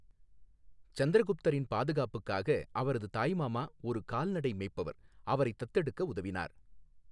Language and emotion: Tamil, neutral